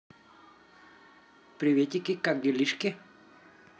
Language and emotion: Russian, positive